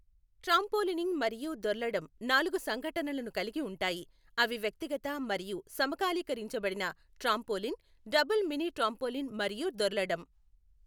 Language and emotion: Telugu, neutral